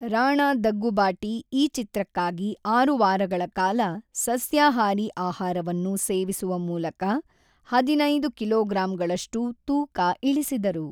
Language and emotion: Kannada, neutral